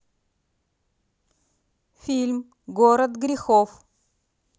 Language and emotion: Russian, neutral